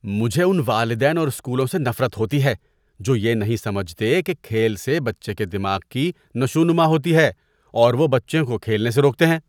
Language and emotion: Urdu, disgusted